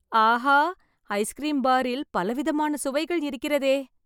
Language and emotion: Tamil, happy